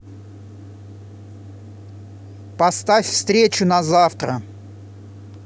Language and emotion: Russian, angry